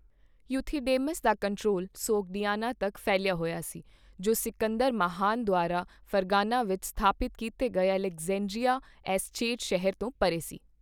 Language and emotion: Punjabi, neutral